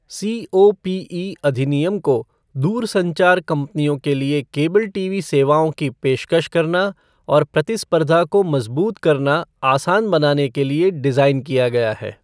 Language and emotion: Hindi, neutral